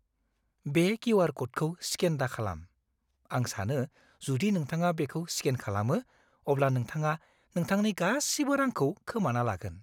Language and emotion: Bodo, fearful